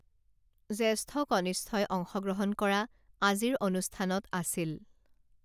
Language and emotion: Assamese, neutral